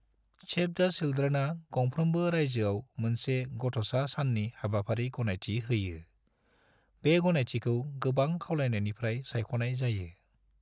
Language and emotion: Bodo, neutral